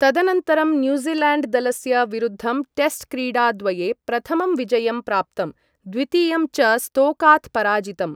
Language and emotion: Sanskrit, neutral